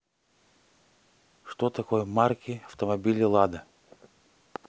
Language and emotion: Russian, neutral